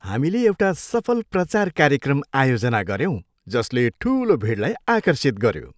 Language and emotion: Nepali, happy